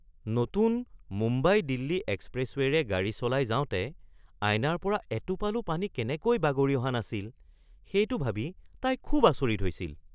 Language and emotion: Assamese, surprised